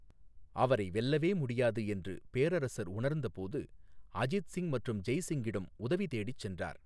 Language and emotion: Tamil, neutral